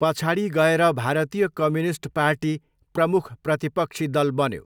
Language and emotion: Nepali, neutral